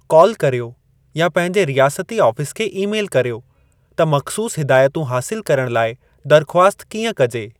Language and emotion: Sindhi, neutral